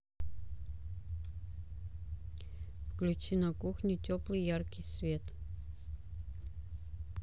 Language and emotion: Russian, neutral